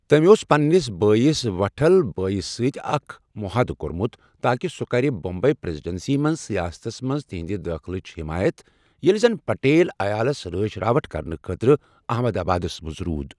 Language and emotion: Kashmiri, neutral